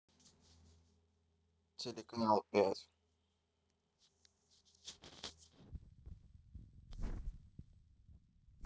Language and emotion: Russian, neutral